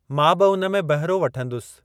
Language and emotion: Sindhi, neutral